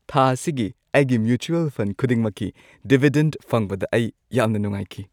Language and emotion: Manipuri, happy